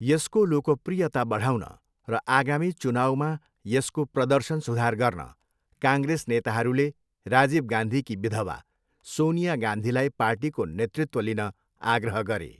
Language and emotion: Nepali, neutral